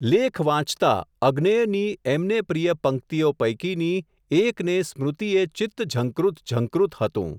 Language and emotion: Gujarati, neutral